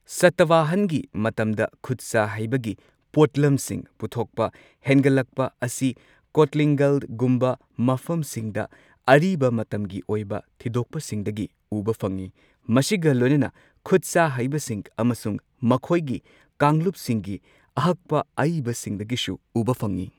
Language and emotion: Manipuri, neutral